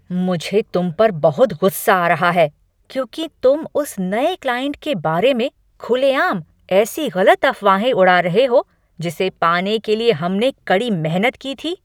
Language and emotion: Hindi, angry